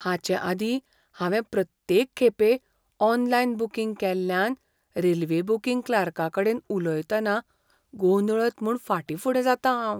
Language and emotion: Goan Konkani, fearful